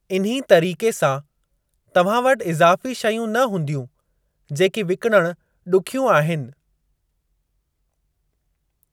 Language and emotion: Sindhi, neutral